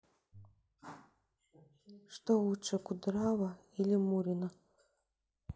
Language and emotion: Russian, sad